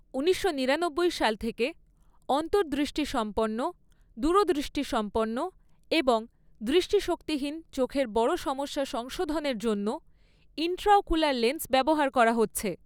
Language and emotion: Bengali, neutral